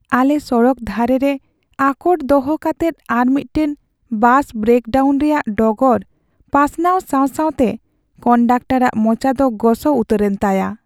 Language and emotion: Santali, sad